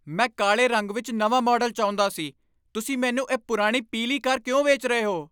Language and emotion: Punjabi, angry